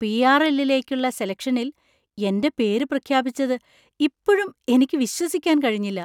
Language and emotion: Malayalam, surprised